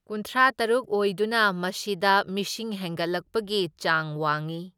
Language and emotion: Manipuri, neutral